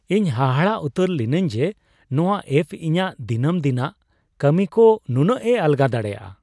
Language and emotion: Santali, surprised